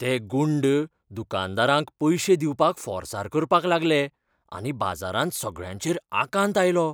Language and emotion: Goan Konkani, fearful